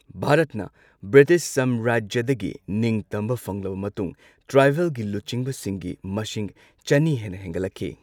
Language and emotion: Manipuri, neutral